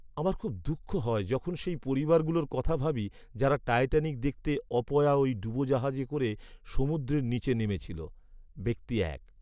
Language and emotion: Bengali, sad